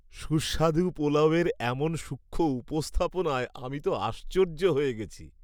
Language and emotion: Bengali, happy